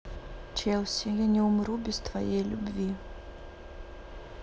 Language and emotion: Russian, sad